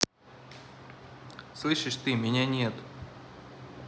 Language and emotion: Russian, angry